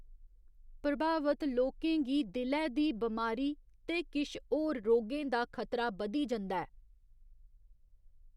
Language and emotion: Dogri, neutral